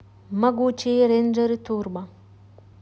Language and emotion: Russian, neutral